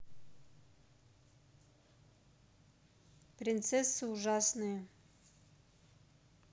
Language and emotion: Russian, neutral